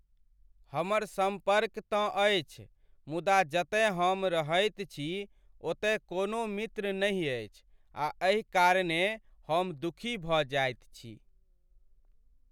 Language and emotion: Maithili, sad